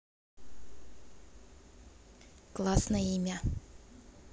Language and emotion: Russian, positive